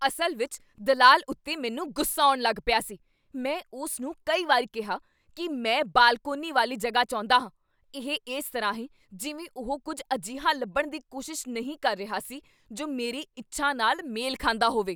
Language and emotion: Punjabi, angry